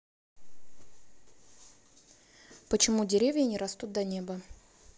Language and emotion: Russian, neutral